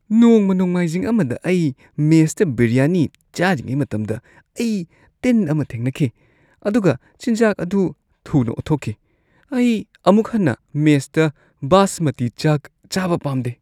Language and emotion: Manipuri, disgusted